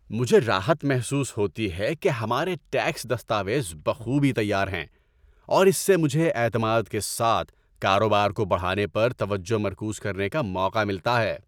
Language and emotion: Urdu, happy